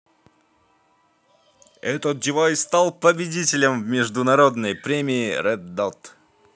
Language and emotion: Russian, positive